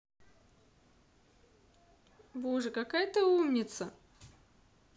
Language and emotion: Russian, positive